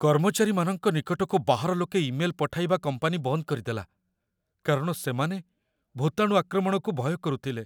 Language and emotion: Odia, fearful